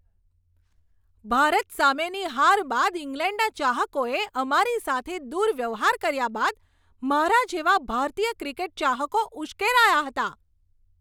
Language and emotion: Gujarati, angry